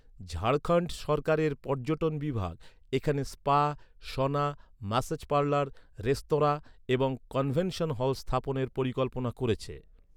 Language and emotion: Bengali, neutral